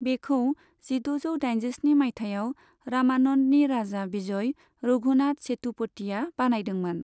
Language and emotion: Bodo, neutral